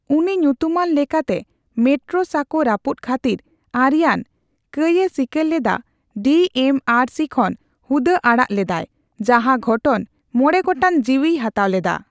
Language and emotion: Santali, neutral